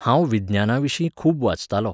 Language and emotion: Goan Konkani, neutral